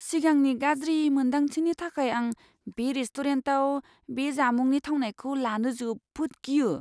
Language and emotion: Bodo, fearful